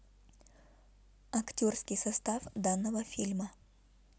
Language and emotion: Russian, neutral